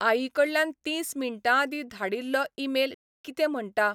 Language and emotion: Goan Konkani, neutral